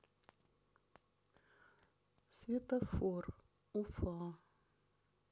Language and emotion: Russian, neutral